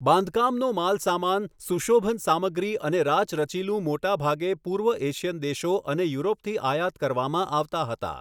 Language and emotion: Gujarati, neutral